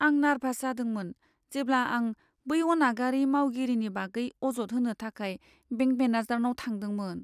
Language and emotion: Bodo, fearful